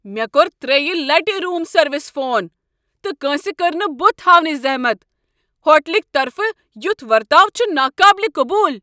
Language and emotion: Kashmiri, angry